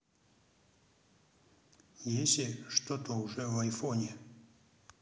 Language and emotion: Russian, neutral